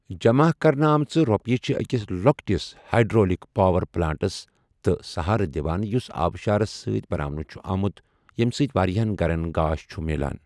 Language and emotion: Kashmiri, neutral